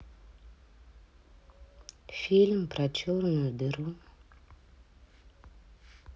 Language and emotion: Russian, neutral